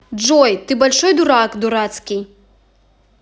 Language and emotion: Russian, angry